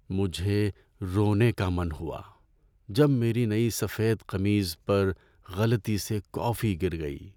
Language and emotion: Urdu, sad